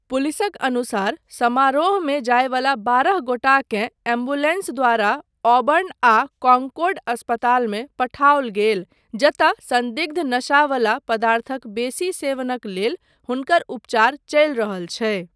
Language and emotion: Maithili, neutral